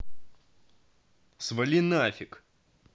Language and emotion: Russian, angry